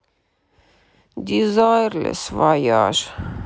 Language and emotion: Russian, sad